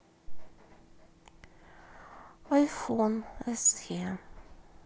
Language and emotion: Russian, sad